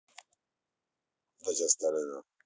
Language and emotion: Russian, neutral